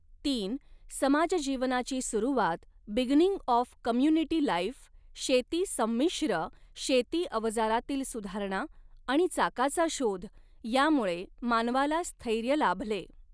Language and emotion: Marathi, neutral